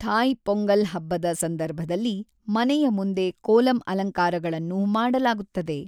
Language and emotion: Kannada, neutral